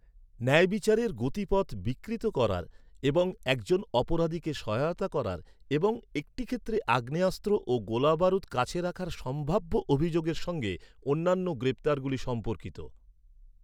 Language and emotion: Bengali, neutral